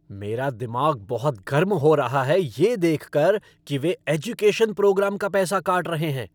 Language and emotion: Hindi, angry